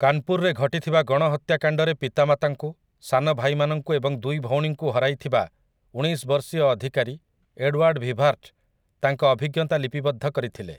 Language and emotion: Odia, neutral